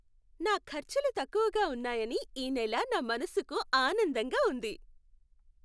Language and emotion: Telugu, happy